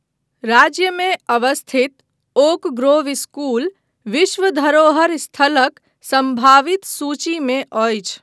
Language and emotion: Maithili, neutral